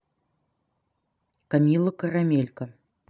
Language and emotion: Russian, neutral